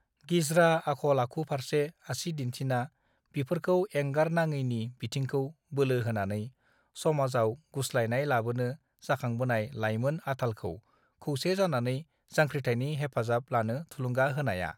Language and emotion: Bodo, neutral